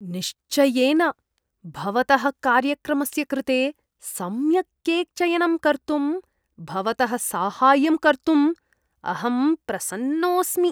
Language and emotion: Sanskrit, disgusted